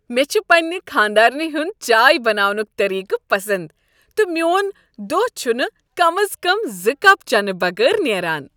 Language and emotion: Kashmiri, happy